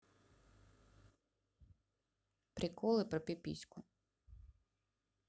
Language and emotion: Russian, neutral